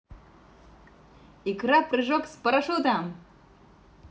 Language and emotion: Russian, positive